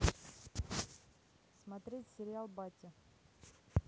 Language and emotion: Russian, neutral